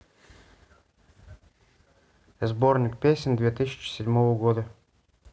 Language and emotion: Russian, neutral